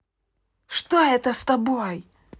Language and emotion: Russian, angry